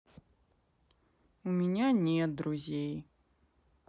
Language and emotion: Russian, sad